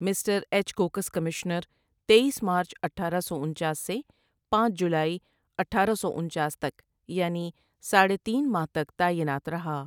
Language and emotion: Urdu, neutral